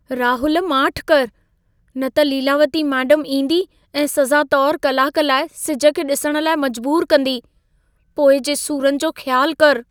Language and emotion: Sindhi, fearful